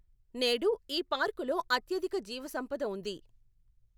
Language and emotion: Telugu, neutral